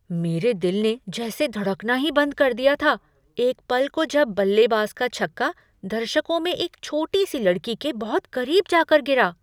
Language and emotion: Hindi, surprised